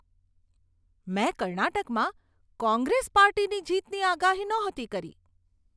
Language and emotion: Gujarati, surprised